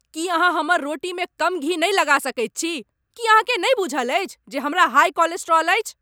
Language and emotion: Maithili, angry